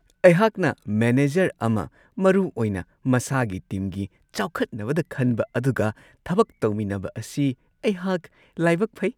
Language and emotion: Manipuri, happy